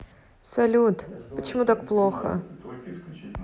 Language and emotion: Russian, sad